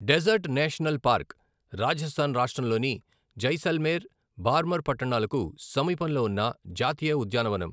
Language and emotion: Telugu, neutral